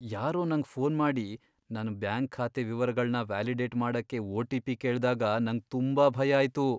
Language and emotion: Kannada, fearful